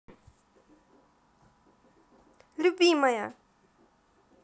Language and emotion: Russian, positive